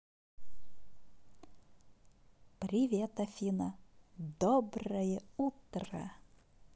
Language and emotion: Russian, positive